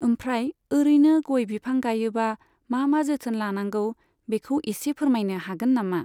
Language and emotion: Bodo, neutral